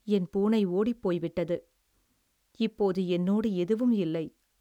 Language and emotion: Tamil, sad